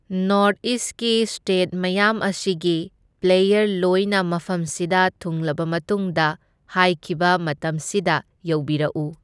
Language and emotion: Manipuri, neutral